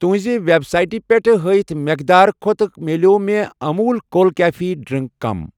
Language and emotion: Kashmiri, neutral